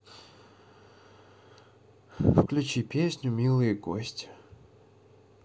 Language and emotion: Russian, sad